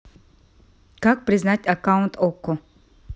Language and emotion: Russian, neutral